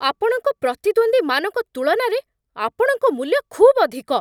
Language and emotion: Odia, angry